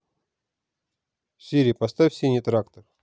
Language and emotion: Russian, neutral